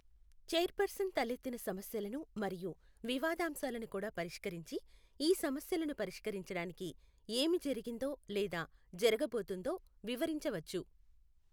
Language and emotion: Telugu, neutral